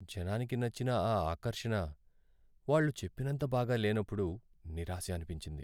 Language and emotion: Telugu, sad